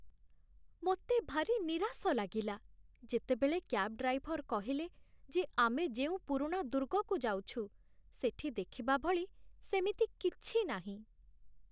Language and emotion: Odia, sad